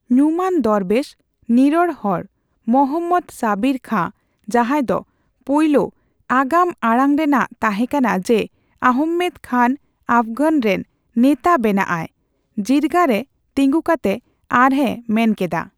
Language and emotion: Santali, neutral